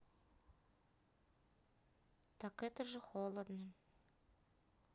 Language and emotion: Russian, sad